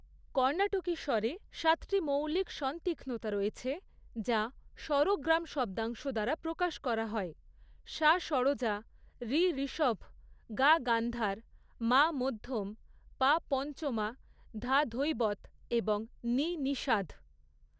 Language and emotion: Bengali, neutral